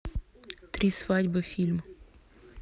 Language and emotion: Russian, neutral